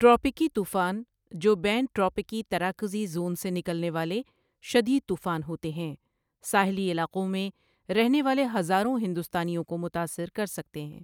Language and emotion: Urdu, neutral